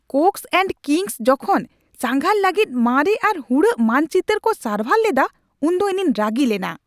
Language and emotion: Santali, angry